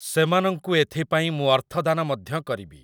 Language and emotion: Odia, neutral